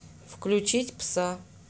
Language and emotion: Russian, neutral